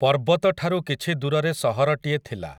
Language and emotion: Odia, neutral